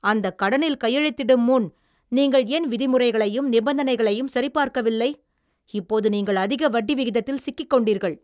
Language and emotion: Tamil, angry